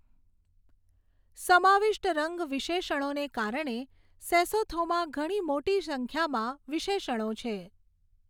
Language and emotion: Gujarati, neutral